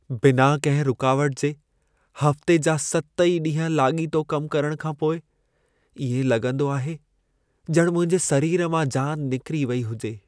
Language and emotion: Sindhi, sad